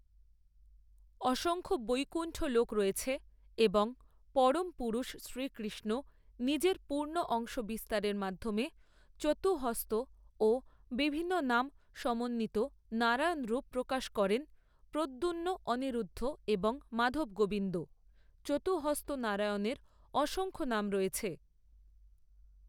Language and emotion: Bengali, neutral